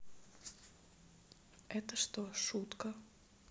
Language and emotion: Russian, sad